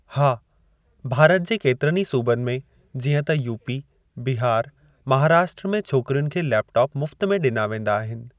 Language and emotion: Sindhi, neutral